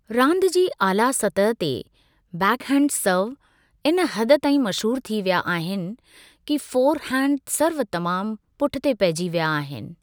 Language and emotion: Sindhi, neutral